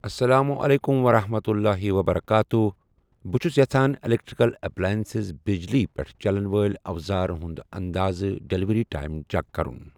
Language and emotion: Kashmiri, neutral